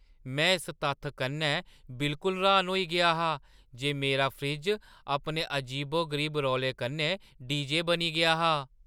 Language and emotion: Dogri, surprised